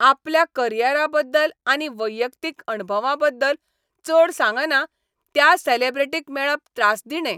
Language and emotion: Goan Konkani, angry